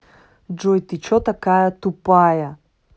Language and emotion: Russian, angry